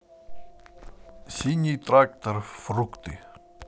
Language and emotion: Russian, neutral